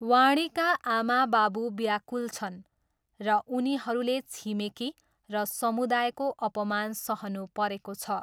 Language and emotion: Nepali, neutral